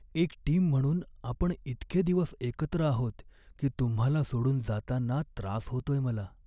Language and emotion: Marathi, sad